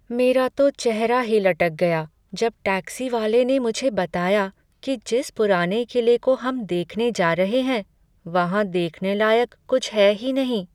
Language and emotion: Hindi, sad